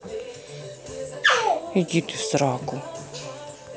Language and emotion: Russian, angry